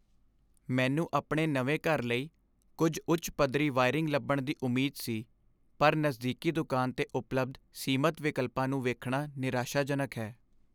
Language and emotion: Punjabi, sad